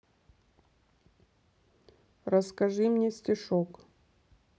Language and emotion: Russian, neutral